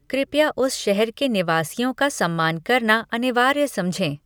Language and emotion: Hindi, neutral